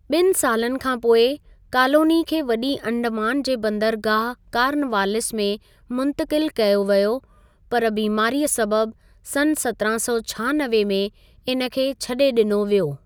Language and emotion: Sindhi, neutral